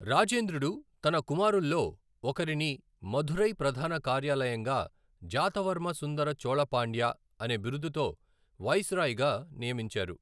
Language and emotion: Telugu, neutral